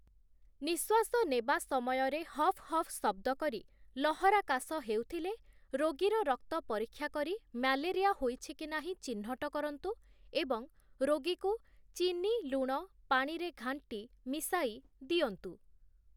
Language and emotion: Odia, neutral